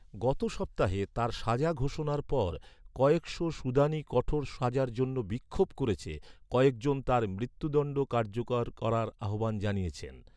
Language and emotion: Bengali, neutral